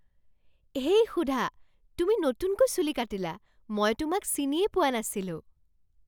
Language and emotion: Assamese, surprised